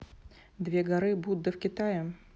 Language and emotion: Russian, neutral